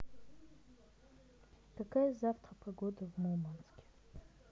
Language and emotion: Russian, neutral